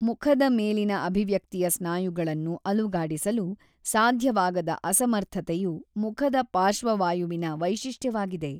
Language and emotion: Kannada, neutral